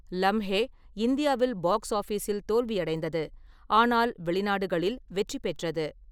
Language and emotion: Tamil, neutral